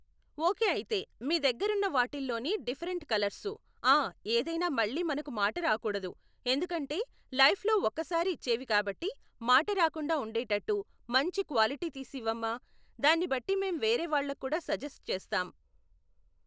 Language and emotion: Telugu, neutral